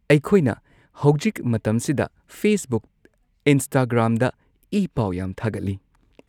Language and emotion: Manipuri, neutral